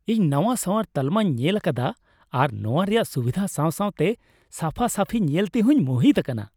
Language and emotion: Santali, happy